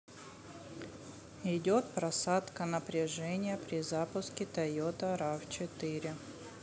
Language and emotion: Russian, neutral